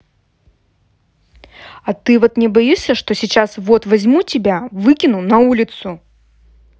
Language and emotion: Russian, angry